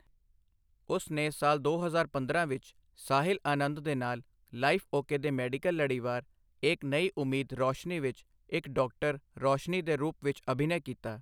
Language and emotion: Punjabi, neutral